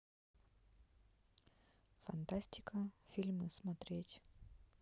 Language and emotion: Russian, neutral